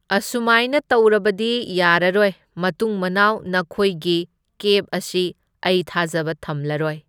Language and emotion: Manipuri, neutral